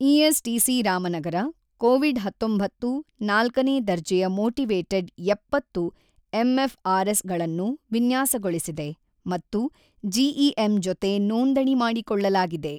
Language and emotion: Kannada, neutral